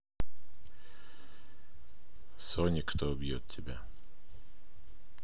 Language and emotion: Russian, neutral